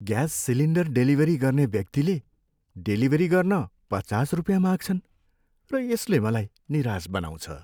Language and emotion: Nepali, sad